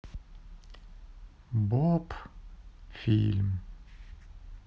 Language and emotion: Russian, sad